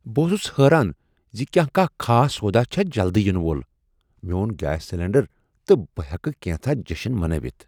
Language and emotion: Kashmiri, surprised